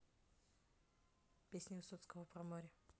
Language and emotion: Russian, neutral